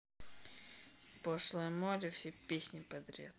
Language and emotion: Russian, angry